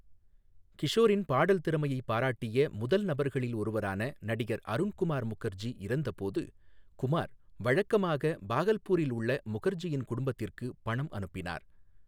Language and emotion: Tamil, neutral